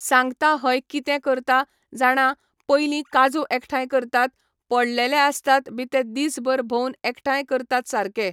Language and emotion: Goan Konkani, neutral